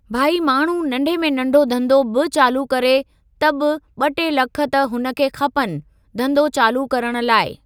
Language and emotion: Sindhi, neutral